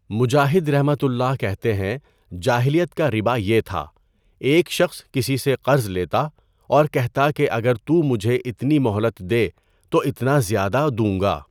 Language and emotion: Urdu, neutral